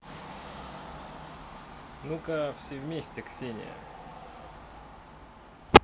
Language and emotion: Russian, positive